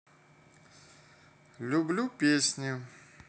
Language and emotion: Russian, neutral